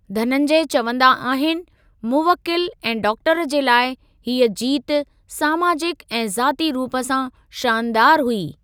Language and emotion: Sindhi, neutral